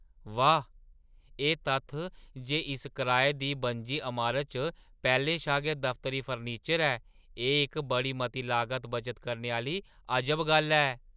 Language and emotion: Dogri, surprised